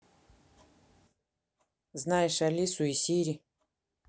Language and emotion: Russian, neutral